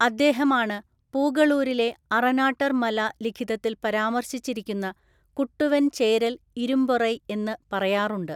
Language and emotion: Malayalam, neutral